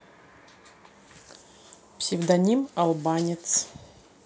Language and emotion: Russian, neutral